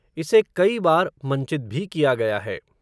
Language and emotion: Hindi, neutral